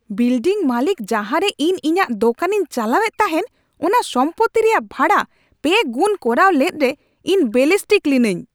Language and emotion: Santali, angry